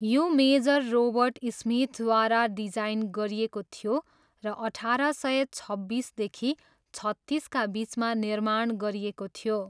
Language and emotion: Nepali, neutral